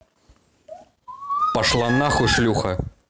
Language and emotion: Russian, angry